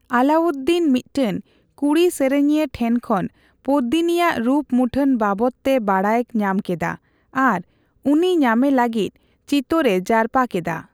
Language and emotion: Santali, neutral